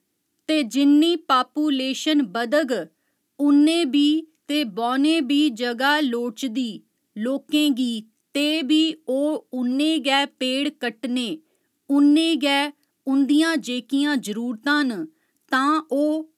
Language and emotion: Dogri, neutral